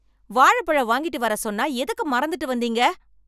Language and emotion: Tamil, angry